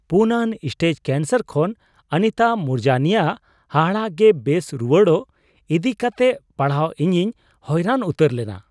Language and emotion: Santali, surprised